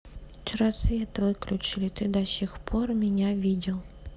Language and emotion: Russian, neutral